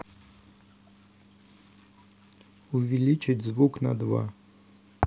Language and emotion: Russian, neutral